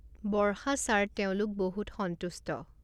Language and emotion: Assamese, neutral